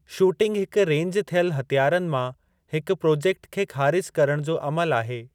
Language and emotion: Sindhi, neutral